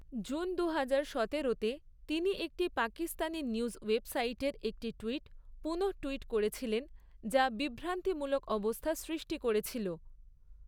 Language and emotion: Bengali, neutral